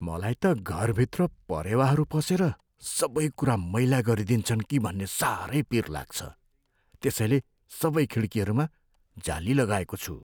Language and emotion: Nepali, fearful